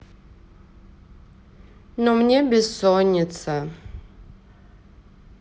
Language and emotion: Russian, sad